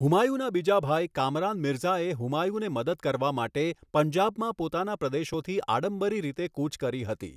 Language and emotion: Gujarati, neutral